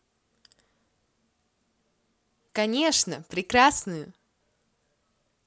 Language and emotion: Russian, positive